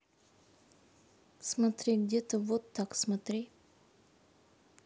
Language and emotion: Russian, neutral